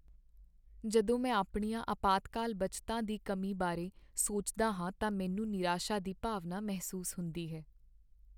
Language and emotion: Punjabi, sad